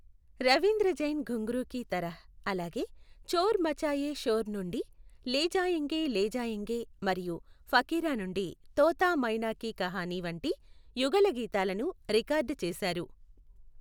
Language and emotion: Telugu, neutral